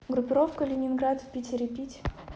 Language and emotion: Russian, neutral